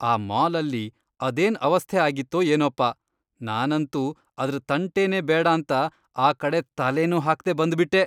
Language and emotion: Kannada, disgusted